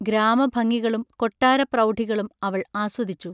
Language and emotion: Malayalam, neutral